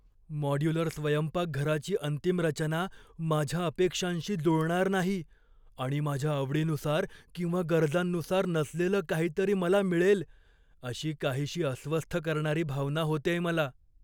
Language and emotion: Marathi, fearful